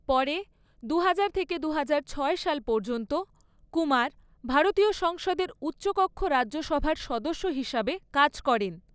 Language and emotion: Bengali, neutral